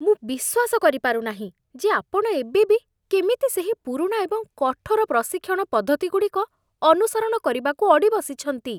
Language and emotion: Odia, disgusted